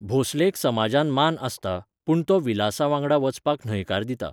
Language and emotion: Goan Konkani, neutral